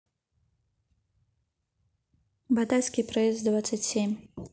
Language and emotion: Russian, neutral